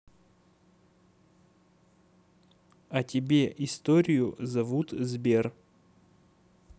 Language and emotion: Russian, neutral